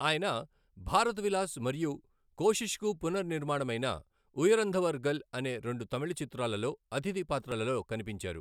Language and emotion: Telugu, neutral